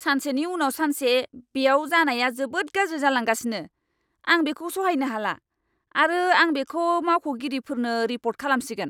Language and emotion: Bodo, angry